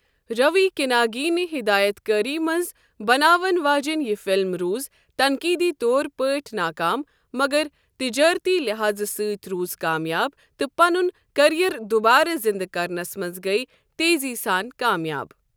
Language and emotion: Kashmiri, neutral